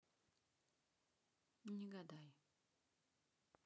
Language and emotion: Russian, neutral